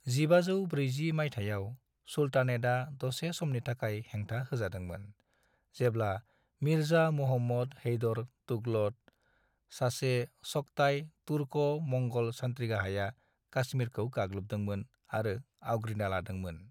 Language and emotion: Bodo, neutral